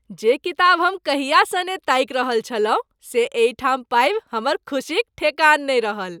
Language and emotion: Maithili, happy